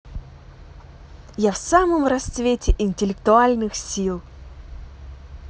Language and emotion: Russian, positive